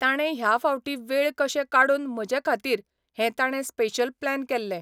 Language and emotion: Goan Konkani, neutral